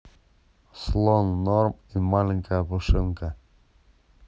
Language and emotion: Russian, neutral